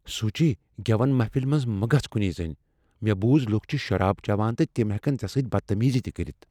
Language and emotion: Kashmiri, fearful